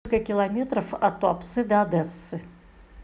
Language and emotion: Russian, neutral